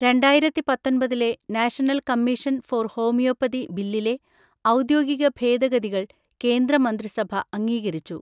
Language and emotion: Malayalam, neutral